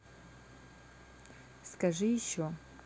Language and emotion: Russian, neutral